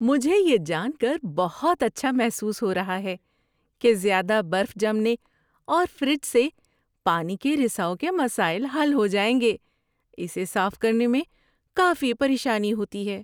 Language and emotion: Urdu, happy